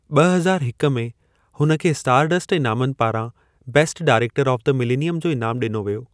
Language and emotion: Sindhi, neutral